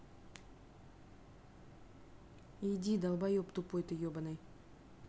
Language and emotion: Russian, angry